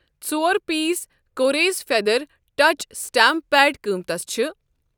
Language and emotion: Kashmiri, neutral